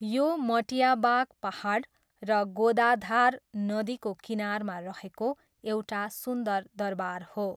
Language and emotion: Nepali, neutral